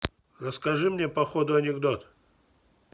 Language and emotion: Russian, neutral